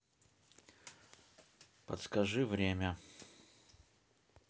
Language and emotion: Russian, neutral